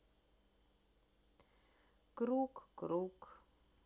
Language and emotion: Russian, sad